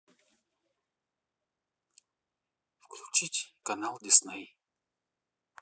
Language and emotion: Russian, neutral